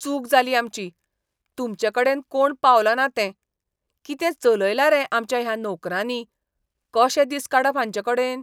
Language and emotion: Goan Konkani, disgusted